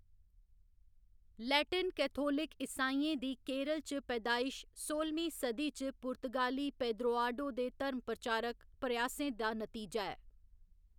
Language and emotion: Dogri, neutral